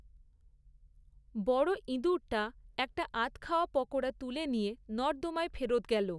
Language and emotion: Bengali, neutral